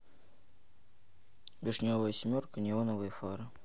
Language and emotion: Russian, neutral